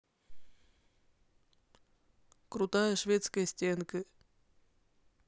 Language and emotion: Russian, neutral